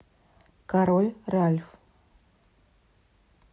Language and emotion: Russian, neutral